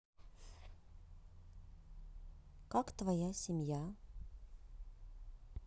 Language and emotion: Russian, neutral